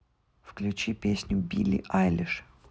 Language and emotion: Russian, neutral